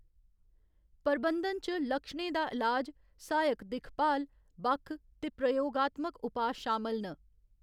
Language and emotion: Dogri, neutral